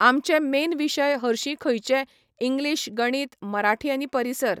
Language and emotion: Goan Konkani, neutral